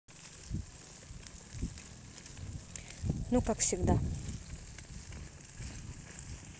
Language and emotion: Russian, neutral